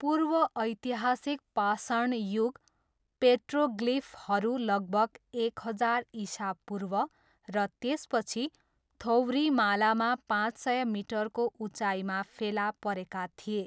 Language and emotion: Nepali, neutral